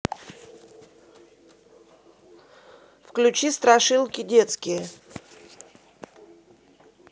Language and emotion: Russian, neutral